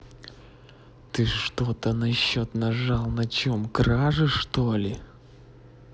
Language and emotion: Russian, angry